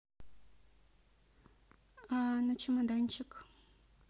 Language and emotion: Russian, neutral